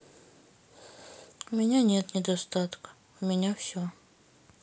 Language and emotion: Russian, sad